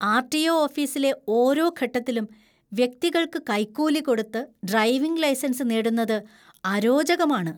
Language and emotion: Malayalam, disgusted